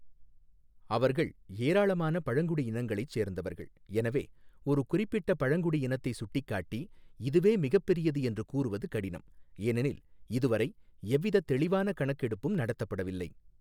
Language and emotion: Tamil, neutral